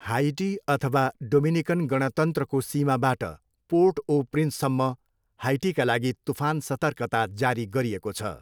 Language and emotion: Nepali, neutral